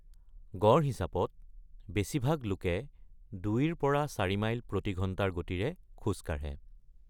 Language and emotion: Assamese, neutral